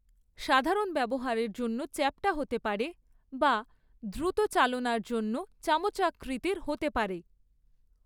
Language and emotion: Bengali, neutral